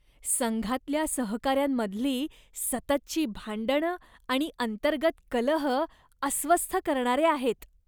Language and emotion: Marathi, disgusted